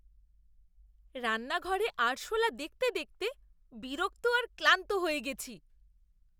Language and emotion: Bengali, disgusted